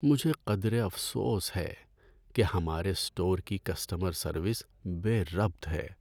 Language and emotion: Urdu, sad